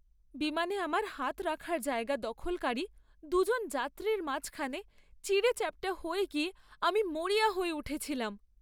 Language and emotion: Bengali, sad